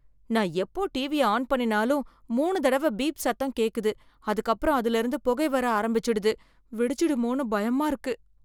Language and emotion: Tamil, fearful